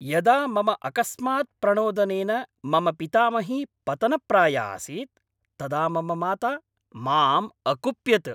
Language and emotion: Sanskrit, angry